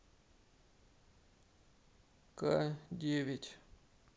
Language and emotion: Russian, sad